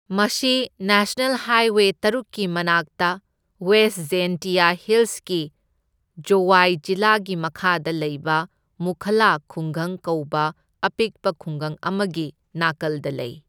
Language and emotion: Manipuri, neutral